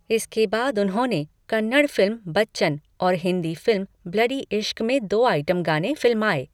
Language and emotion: Hindi, neutral